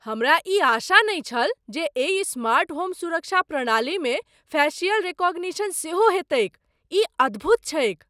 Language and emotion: Maithili, surprised